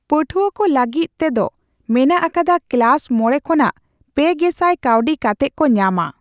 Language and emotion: Santali, neutral